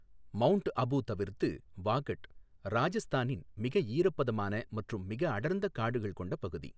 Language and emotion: Tamil, neutral